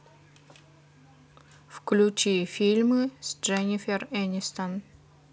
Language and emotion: Russian, neutral